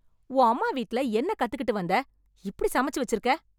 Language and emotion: Tamil, angry